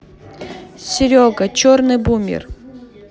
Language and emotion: Russian, neutral